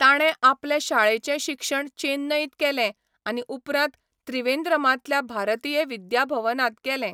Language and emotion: Goan Konkani, neutral